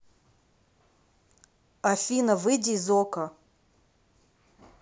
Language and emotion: Russian, neutral